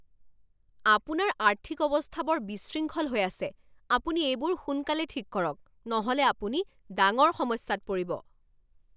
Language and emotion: Assamese, angry